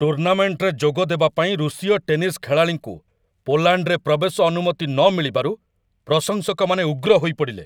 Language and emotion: Odia, angry